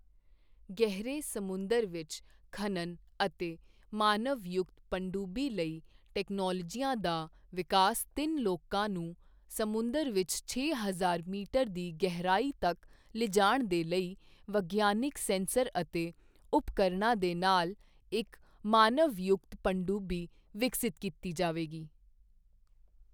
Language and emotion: Punjabi, neutral